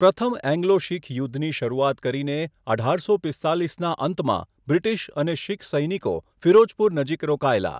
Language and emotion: Gujarati, neutral